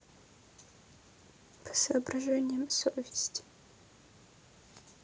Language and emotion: Russian, sad